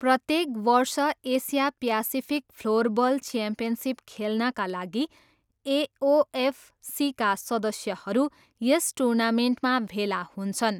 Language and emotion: Nepali, neutral